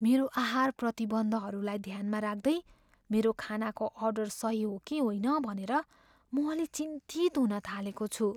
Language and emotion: Nepali, fearful